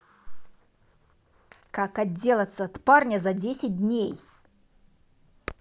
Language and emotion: Russian, angry